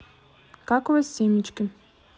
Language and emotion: Russian, neutral